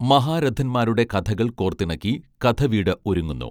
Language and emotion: Malayalam, neutral